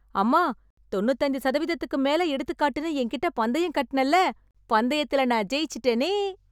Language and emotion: Tamil, happy